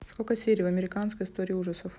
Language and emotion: Russian, neutral